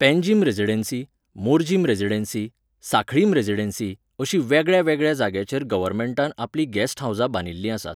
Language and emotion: Goan Konkani, neutral